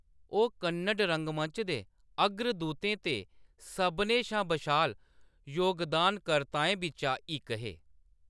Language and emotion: Dogri, neutral